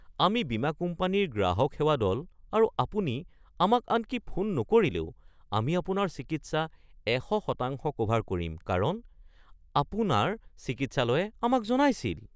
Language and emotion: Assamese, surprised